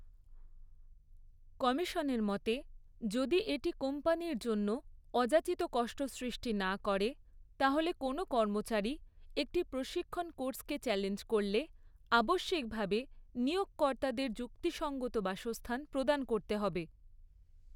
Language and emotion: Bengali, neutral